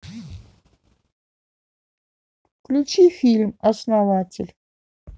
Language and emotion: Russian, neutral